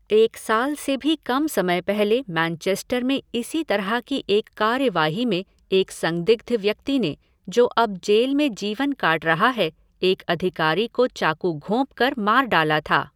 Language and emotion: Hindi, neutral